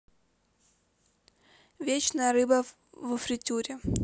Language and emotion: Russian, neutral